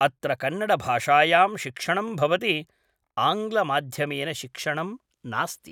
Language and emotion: Sanskrit, neutral